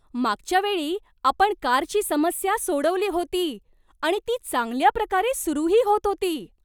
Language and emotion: Marathi, surprised